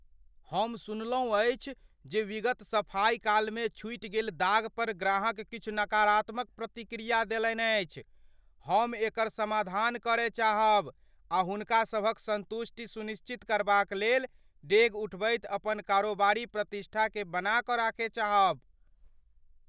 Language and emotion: Maithili, fearful